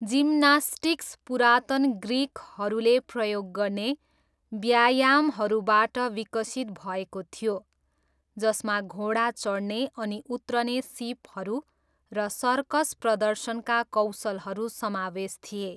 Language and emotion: Nepali, neutral